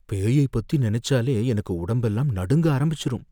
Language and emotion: Tamil, fearful